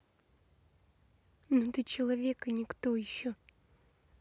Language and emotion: Russian, angry